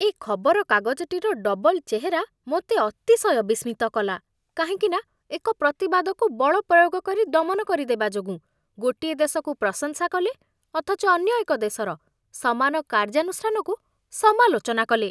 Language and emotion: Odia, disgusted